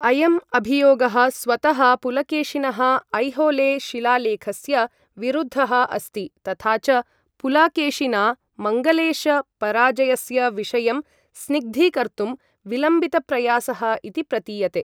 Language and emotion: Sanskrit, neutral